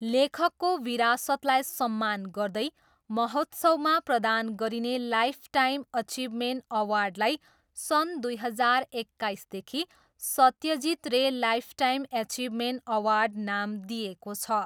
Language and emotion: Nepali, neutral